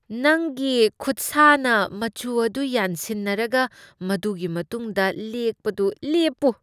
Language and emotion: Manipuri, disgusted